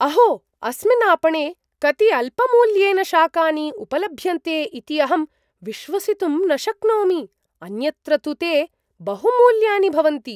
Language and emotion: Sanskrit, surprised